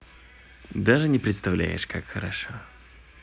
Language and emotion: Russian, positive